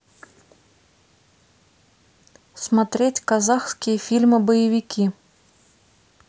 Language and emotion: Russian, neutral